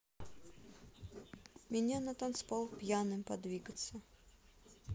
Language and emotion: Russian, neutral